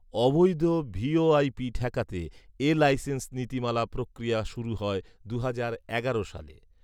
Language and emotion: Bengali, neutral